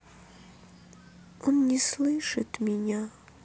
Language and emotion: Russian, sad